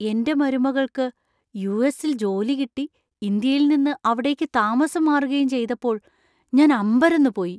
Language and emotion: Malayalam, surprised